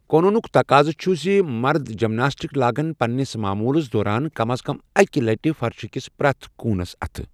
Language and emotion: Kashmiri, neutral